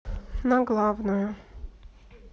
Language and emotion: Russian, neutral